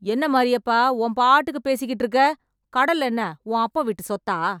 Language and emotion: Tamil, angry